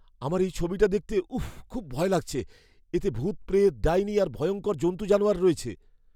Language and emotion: Bengali, fearful